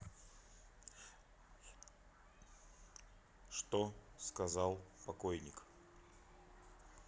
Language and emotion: Russian, neutral